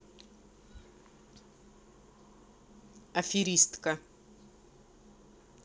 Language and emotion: Russian, neutral